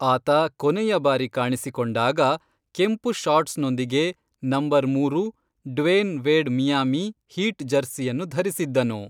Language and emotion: Kannada, neutral